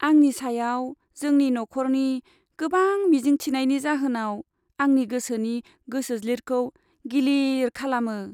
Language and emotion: Bodo, sad